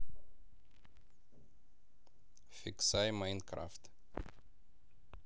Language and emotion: Russian, neutral